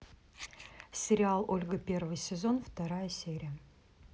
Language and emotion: Russian, neutral